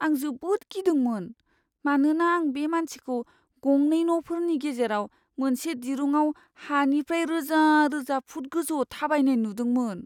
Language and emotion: Bodo, fearful